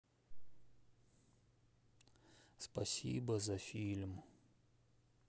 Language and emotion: Russian, sad